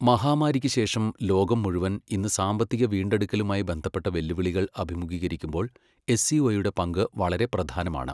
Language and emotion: Malayalam, neutral